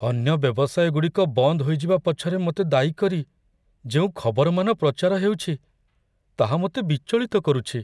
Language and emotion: Odia, fearful